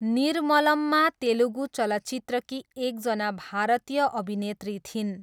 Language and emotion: Nepali, neutral